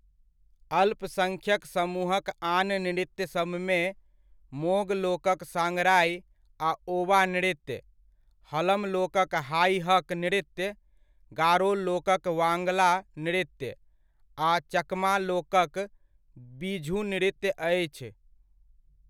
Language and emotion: Maithili, neutral